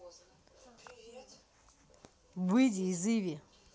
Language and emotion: Russian, angry